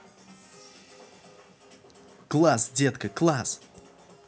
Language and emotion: Russian, positive